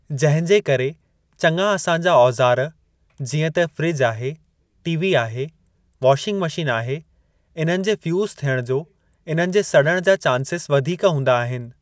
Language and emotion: Sindhi, neutral